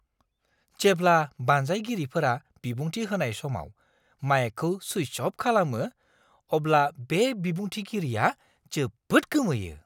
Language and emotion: Bodo, surprised